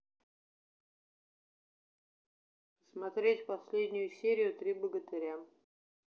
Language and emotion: Russian, neutral